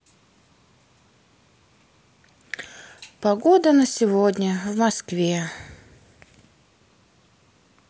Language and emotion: Russian, sad